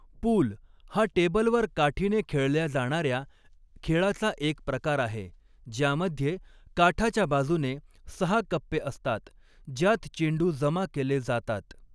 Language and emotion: Marathi, neutral